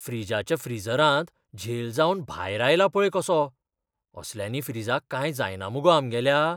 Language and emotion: Goan Konkani, fearful